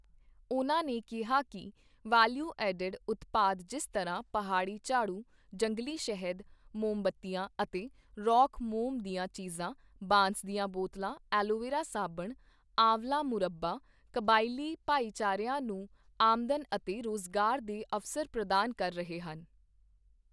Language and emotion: Punjabi, neutral